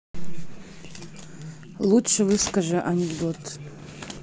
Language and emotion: Russian, neutral